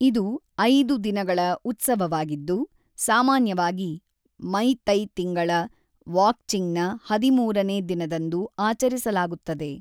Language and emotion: Kannada, neutral